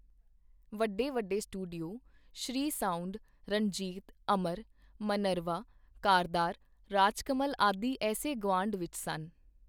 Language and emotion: Punjabi, neutral